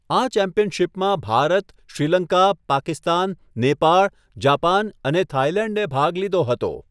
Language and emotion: Gujarati, neutral